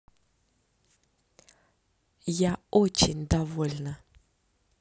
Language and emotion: Russian, positive